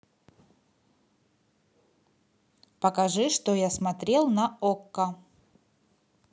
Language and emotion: Russian, neutral